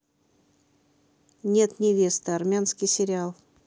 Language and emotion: Russian, neutral